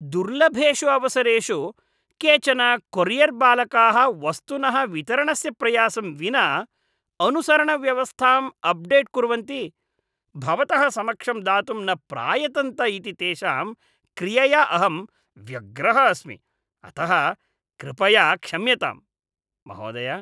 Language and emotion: Sanskrit, disgusted